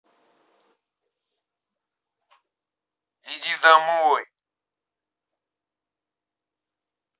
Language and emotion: Russian, angry